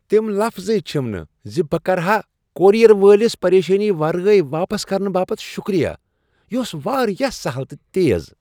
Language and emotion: Kashmiri, happy